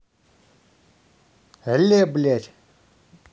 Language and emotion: Russian, angry